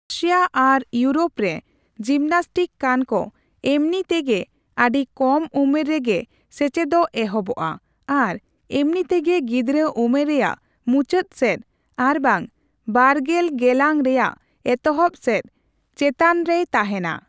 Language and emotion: Santali, neutral